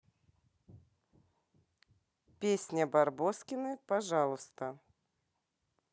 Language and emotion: Russian, positive